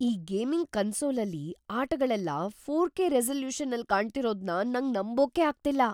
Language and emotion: Kannada, surprised